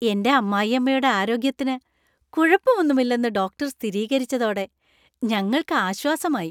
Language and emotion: Malayalam, happy